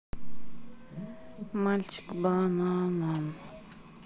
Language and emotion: Russian, sad